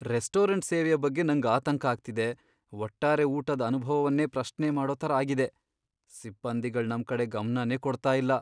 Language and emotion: Kannada, fearful